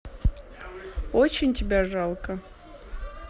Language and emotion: Russian, neutral